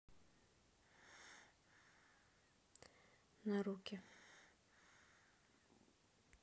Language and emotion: Russian, neutral